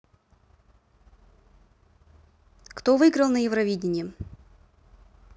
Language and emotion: Russian, neutral